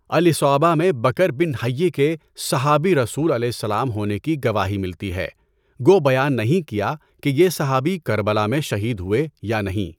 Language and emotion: Urdu, neutral